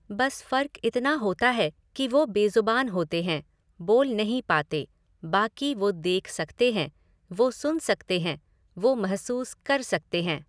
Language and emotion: Hindi, neutral